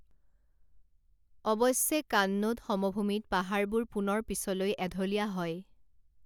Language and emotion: Assamese, neutral